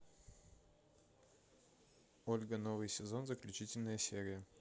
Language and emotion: Russian, neutral